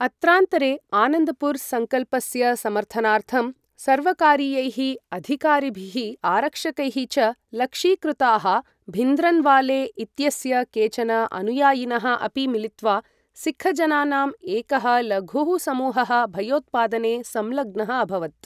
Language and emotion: Sanskrit, neutral